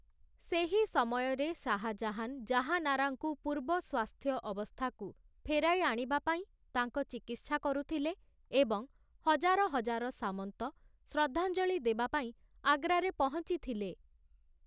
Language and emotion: Odia, neutral